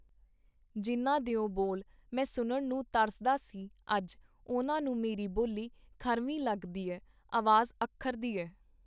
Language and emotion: Punjabi, neutral